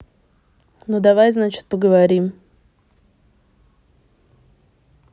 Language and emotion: Russian, neutral